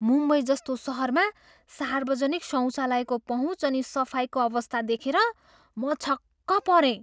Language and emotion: Nepali, surprised